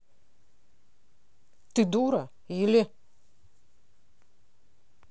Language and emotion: Russian, angry